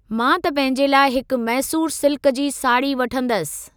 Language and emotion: Sindhi, neutral